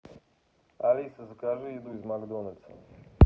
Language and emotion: Russian, neutral